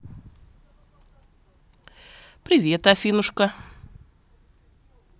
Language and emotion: Russian, positive